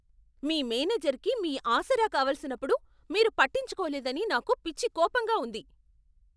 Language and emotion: Telugu, angry